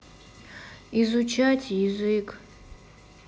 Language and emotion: Russian, sad